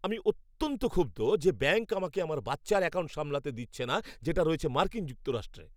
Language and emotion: Bengali, angry